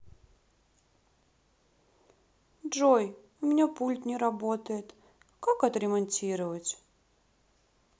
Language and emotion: Russian, sad